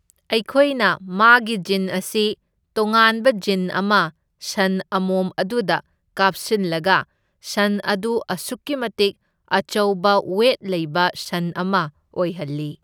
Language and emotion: Manipuri, neutral